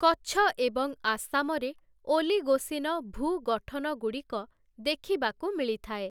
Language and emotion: Odia, neutral